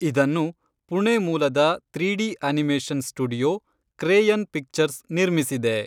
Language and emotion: Kannada, neutral